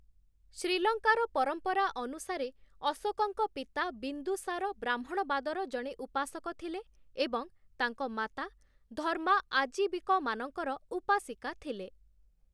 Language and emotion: Odia, neutral